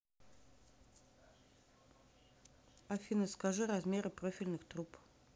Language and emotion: Russian, neutral